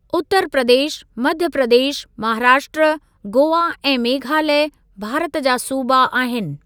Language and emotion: Sindhi, neutral